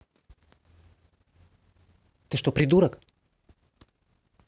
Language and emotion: Russian, angry